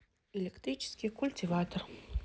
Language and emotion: Russian, neutral